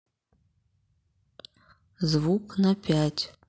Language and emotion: Russian, neutral